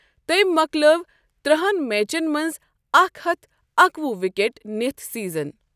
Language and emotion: Kashmiri, neutral